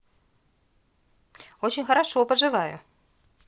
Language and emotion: Russian, positive